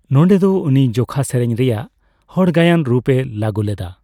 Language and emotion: Santali, neutral